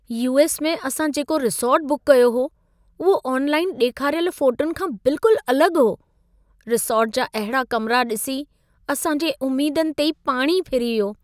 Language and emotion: Sindhi, sad